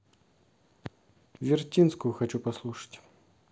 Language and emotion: Russian, neutral